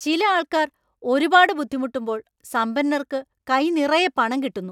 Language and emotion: Malayalam, angry